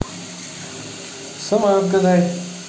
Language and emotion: Russian, positive